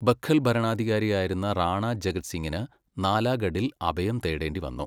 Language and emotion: Malayalam, neutral